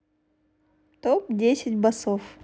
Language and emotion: Russian, neutral